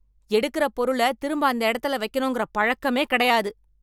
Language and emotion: Tamil, angry